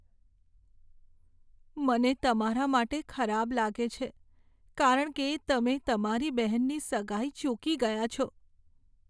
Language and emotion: Gujarati, sad